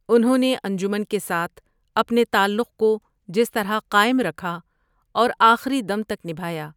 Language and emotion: Urdu, neutral